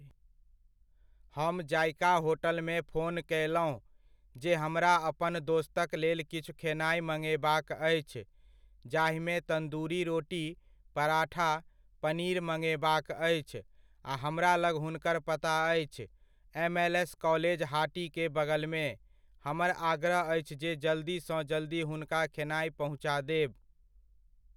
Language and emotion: Maithili, neutral